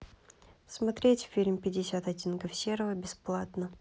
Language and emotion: Russian, neutral